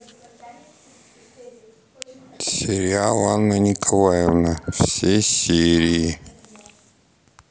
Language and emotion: Russian, neutral